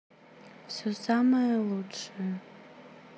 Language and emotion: Russian, neutral